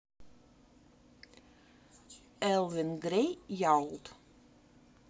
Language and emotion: Russian, neutral